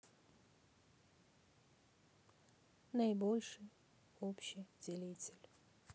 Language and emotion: Russian, neutral